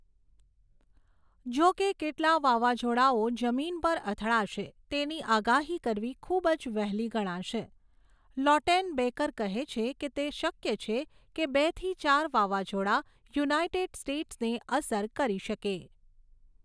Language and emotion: Gujarati, neutral